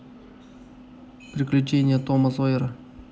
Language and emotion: Russian, neutral